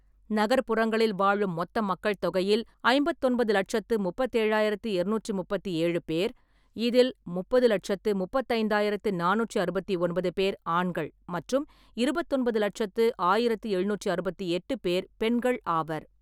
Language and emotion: Tamil, neutral